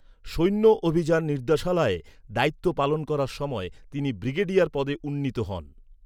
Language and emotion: Bengali, neutral